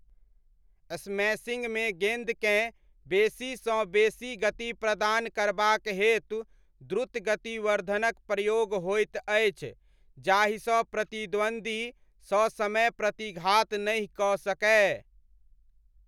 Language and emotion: Maithili, neutral